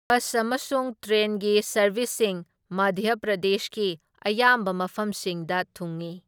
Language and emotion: Manipuri, neutral